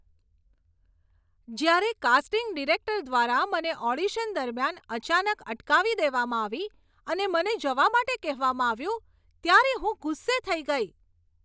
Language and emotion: Gujarati, angry